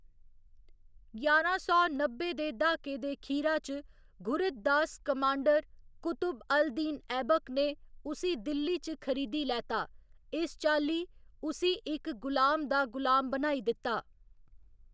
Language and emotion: Dogri, neutral